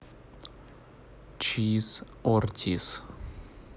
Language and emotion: Russian, neutral